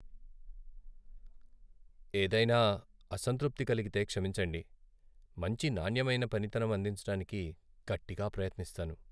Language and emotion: Telugu, sad